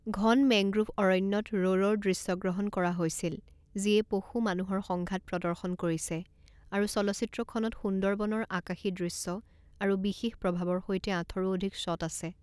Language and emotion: Assamese, neutral